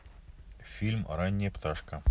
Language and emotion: Russian, neutral